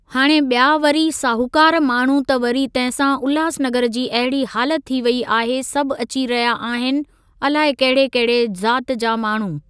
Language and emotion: Sindhi, neutral